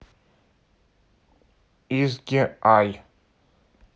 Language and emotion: Russian, neutral